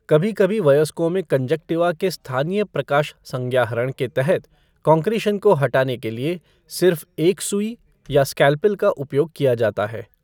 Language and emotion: Hindi, neutral